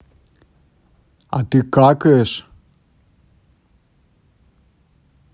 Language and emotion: Russian, neutral